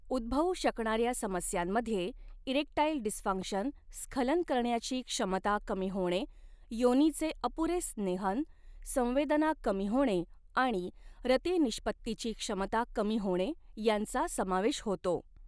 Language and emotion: Marathi, neutral